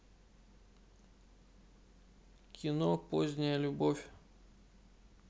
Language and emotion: Russian, neutral